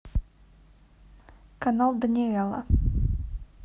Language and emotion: Russian, neutral